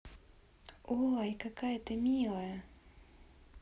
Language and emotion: Russian, positive